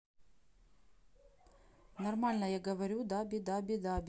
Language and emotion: Russian, neutral